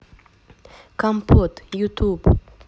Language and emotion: Russian, neutral